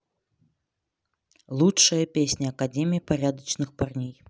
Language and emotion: Russian, neutral